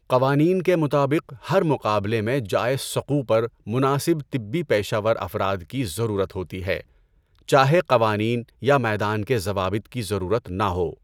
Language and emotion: Urdu, neutral